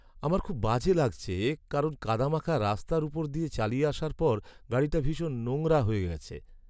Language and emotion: Bengali, sad